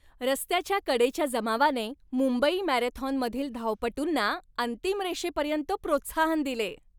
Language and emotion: Marathi, happy